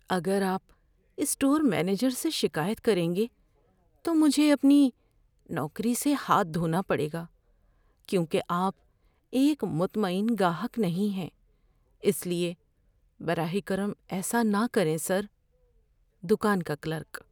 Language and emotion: Urdu, fearful